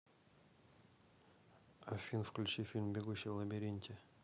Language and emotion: Russian, neutral